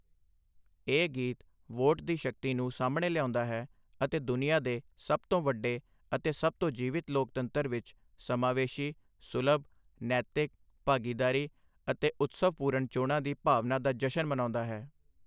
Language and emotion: Punjabi, neutral